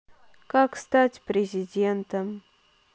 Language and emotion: Russian, sad